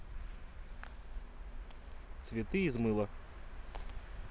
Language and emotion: Russian, neutral